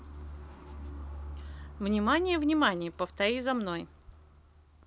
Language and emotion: Russian, positive